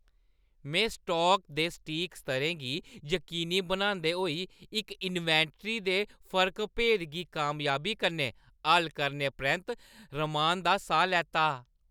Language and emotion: Dogri, happy